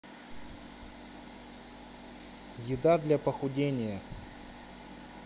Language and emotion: Russian, neutral